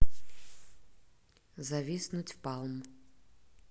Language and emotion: Russian, neutral